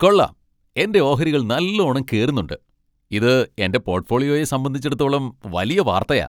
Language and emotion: Malayalam, happy